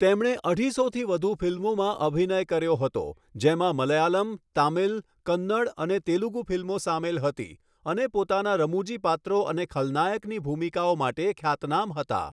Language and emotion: Gujarati, neutral